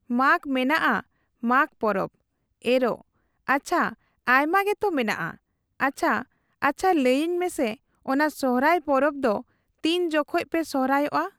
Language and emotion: Santali, neutral